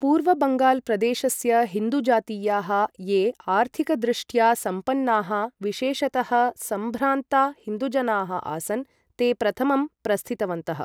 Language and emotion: Sanskrit, neutral